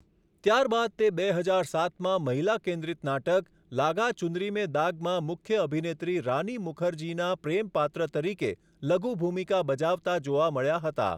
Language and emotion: Gujarati, neutral